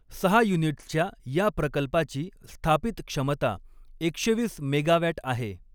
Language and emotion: Marathi, neutral